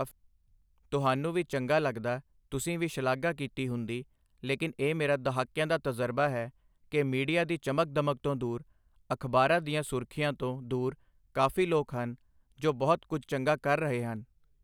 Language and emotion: Punjabi, neutral